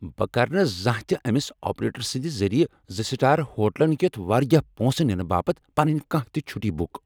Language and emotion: Kashmiri, angry